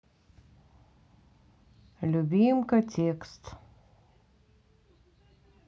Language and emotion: Russian, neutral